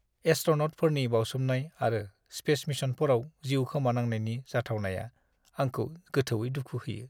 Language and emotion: Bodo, sad